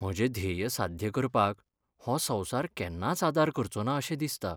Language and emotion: Goan Konkani, sad